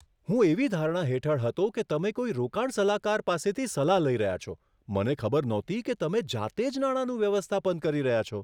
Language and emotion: Gujarati, surprised